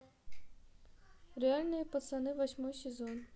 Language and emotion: Russian, neutral